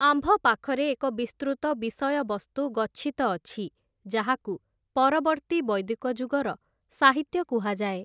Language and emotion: Odia, neutral